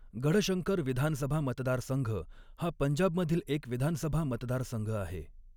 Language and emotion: Marathi, neutral